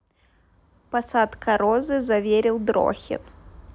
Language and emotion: Russian, neutral